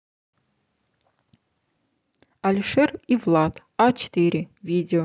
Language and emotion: Russian, neutral